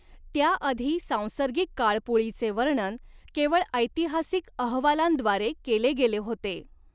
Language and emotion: Marathi, neutral